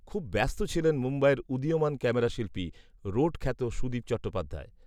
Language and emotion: Bengali, neutral